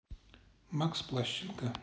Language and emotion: Russian, neutral